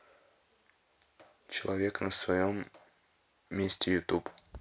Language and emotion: Russian, neutral